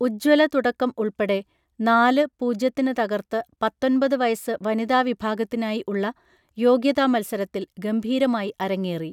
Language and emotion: Malayalam, neutral